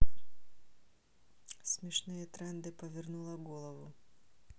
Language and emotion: Russian, neutral